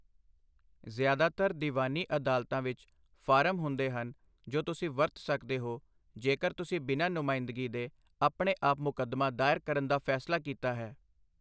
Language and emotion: Punjabi, neutral